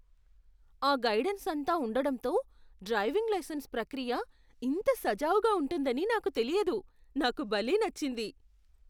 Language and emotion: Telugu, surprised